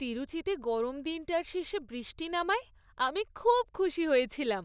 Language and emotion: Bengali, happy